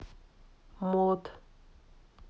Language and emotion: Russian, neutral